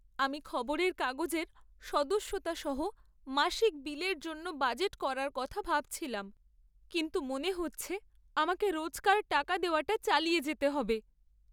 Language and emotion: Bengali, sad